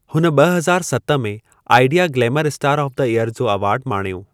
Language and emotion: Sindhi, neutral